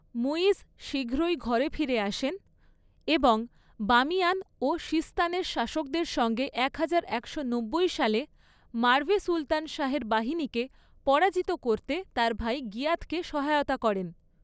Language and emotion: Bengali, neutral